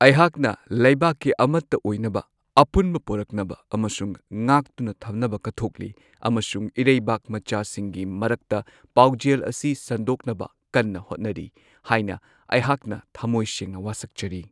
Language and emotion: Manipuri, neutral